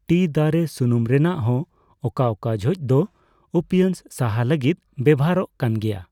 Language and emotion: Santali, neutral